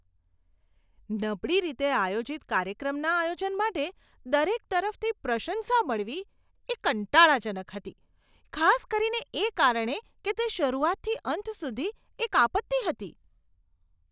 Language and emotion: Gujarati, disgusted